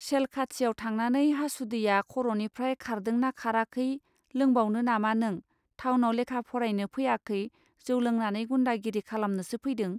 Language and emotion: Bodo, neutral